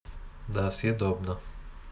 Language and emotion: Russian, neutral